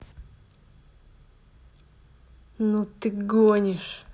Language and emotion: Russian, angry